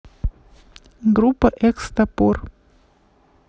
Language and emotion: Russian, neutral